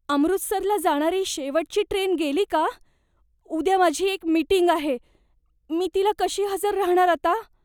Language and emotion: Marathi, fearful